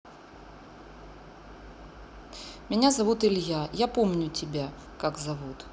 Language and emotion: Russian, neutral